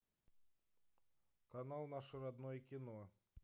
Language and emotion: Russian, neutral